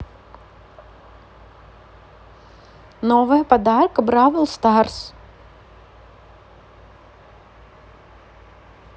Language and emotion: Russian, neutral